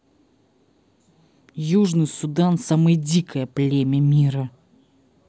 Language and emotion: Russian, angry